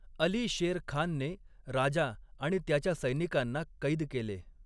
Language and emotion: Marathi, neutral